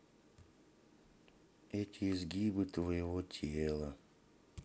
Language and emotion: Russian, sad